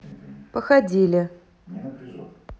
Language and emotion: Russian, neutral